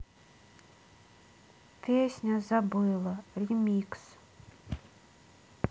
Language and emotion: Russian, sad